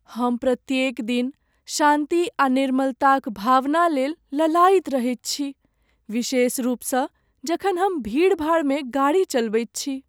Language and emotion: Maithili, sad